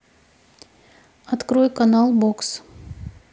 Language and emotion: Russian, neutral